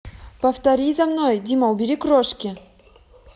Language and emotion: Russian, neutral